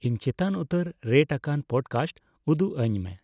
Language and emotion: Santali, neutral